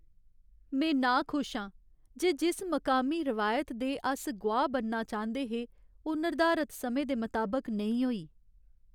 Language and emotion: Dogri, sad